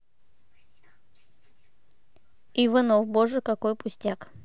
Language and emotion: Russian, neutral